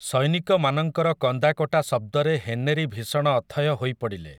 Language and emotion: Odia, neutral